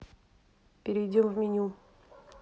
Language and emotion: Russian, neutral